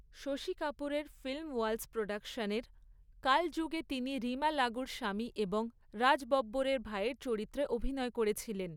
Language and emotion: Bengali, neutral